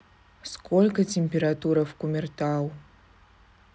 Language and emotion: Russian, neutral